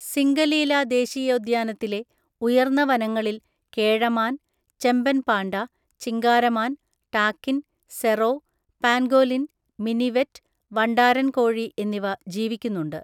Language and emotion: Malayalam, neutral